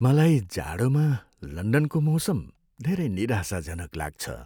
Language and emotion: Nepali, sad